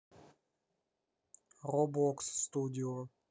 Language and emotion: Russian, neutral